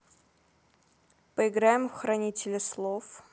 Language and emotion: Russian, neutral